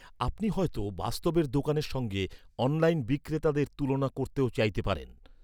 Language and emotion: Bengali, neutral